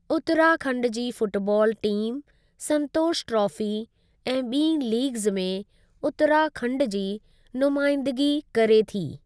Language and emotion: Sindhi, neutral